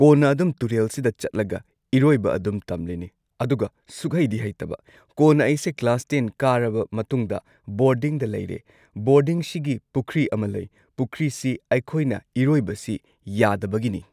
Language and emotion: Manipuri, neutral